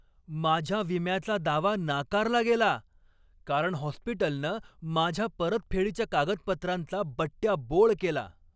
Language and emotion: Marathi, angry